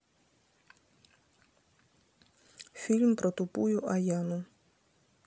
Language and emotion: Russian, neutral